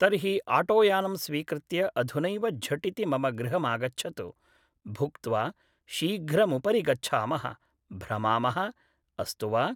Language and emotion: Sanskrit, neutral